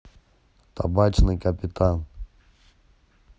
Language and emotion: Russian, neutral